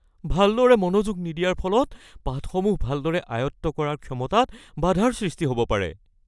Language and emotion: Assamese, fearful